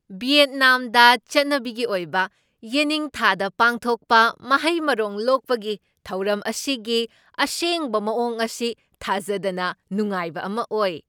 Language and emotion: Manipuri, surprised